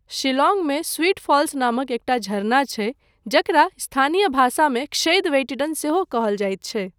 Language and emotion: Maithili, neutral